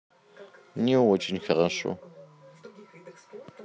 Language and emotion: Russian, sad